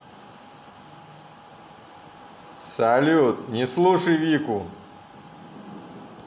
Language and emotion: Russian, positive